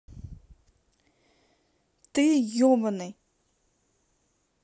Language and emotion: Russian, angry